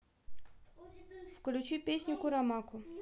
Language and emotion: Russian, neutral